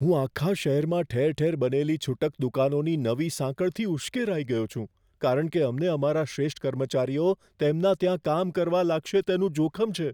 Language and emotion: Gujarati, fearful